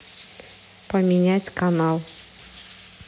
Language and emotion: Russian, neutral